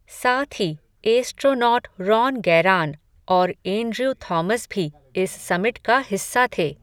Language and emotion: Hindi, neutral